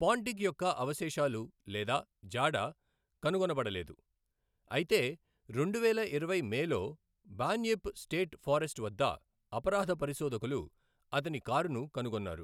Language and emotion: Telugu, neutral